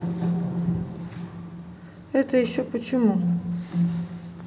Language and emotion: Russian, neutral